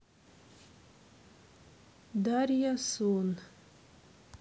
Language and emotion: Russian, neutral